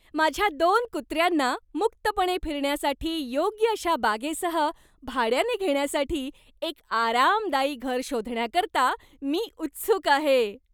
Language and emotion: Marathi, happy